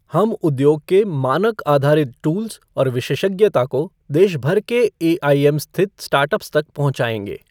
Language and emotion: Hindi, neutral